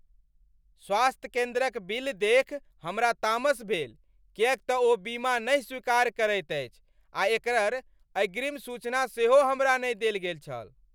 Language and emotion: Maithili, angry